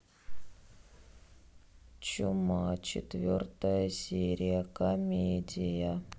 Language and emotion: Russian, sad